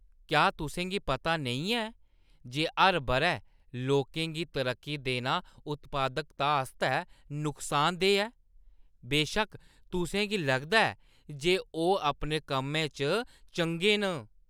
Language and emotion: Dogri, disgusted